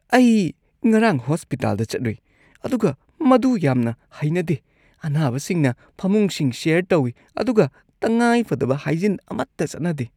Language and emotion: Manipuri, disgusted